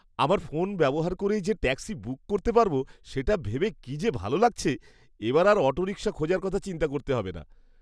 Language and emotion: Bengali, happy